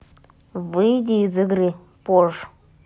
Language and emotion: Russian, neutral